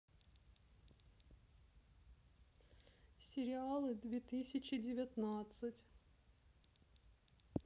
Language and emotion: Russian, sad